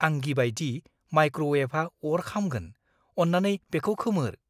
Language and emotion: Bodo, fearful